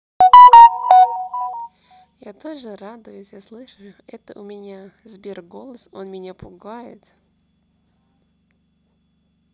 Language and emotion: Russian, neutral